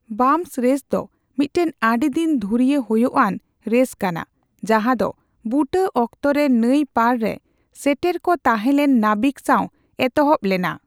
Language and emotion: Santali, neutral